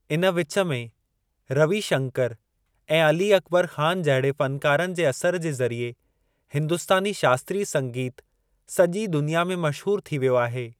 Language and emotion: Sindhi, neutral